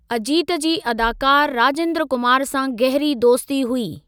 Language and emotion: Sindhi, neutral